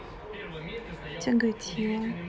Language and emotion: Russian, neutral